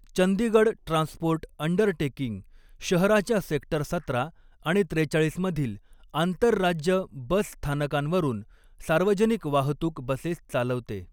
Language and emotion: Marathi, neutral